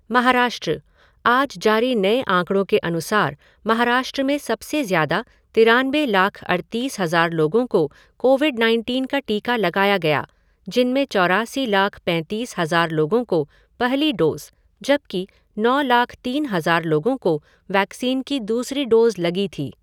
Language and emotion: Hindi, neutral